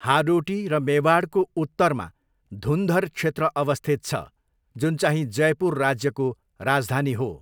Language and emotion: Nepali, neutral